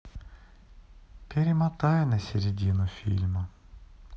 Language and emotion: Russian, sad